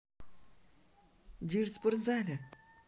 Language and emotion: Russian, neutral